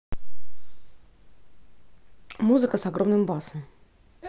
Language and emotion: Russian, neutral